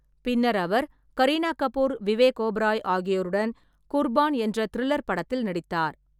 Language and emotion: Tamil, neutral